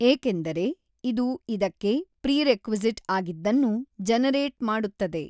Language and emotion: Kannada, neutral